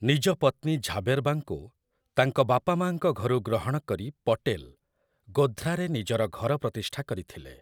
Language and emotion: Odia, neutral